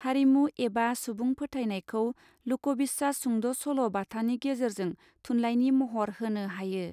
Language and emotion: Bodo, neutral